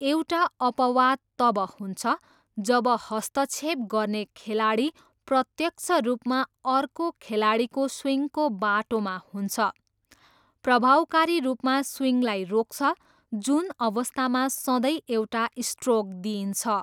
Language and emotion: Nepali, neutral